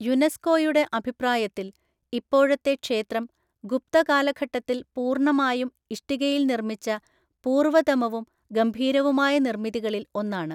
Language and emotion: Malayalam, neutral